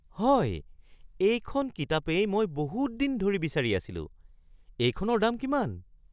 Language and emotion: Assamese, surprised